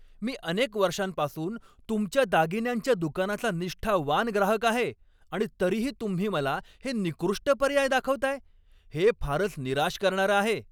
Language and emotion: Marathi, angry